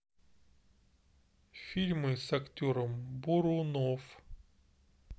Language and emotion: Russian, neutral